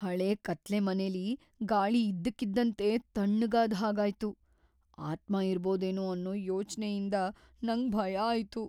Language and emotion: Kannada, fearful